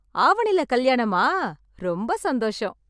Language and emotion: Tamil, happy